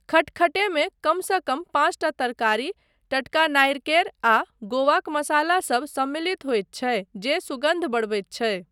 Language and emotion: Maithili, neutral